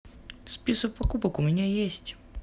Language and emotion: Russian, neutral